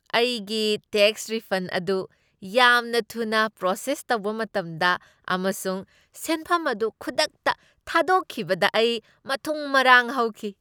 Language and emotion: Manipuri, happy